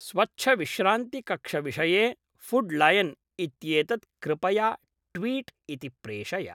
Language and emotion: Sanskrit, neutral